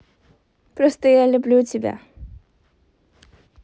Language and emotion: Russian, positive